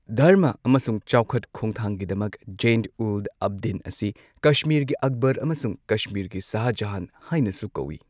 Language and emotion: Manipuri, neutral